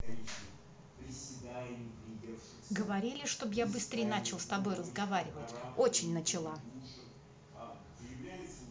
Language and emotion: Russian, angry